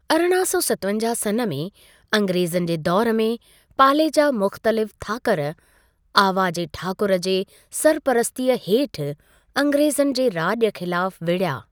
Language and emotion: Sindhi, neutral